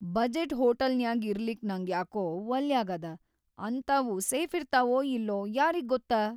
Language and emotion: Kannada, fearful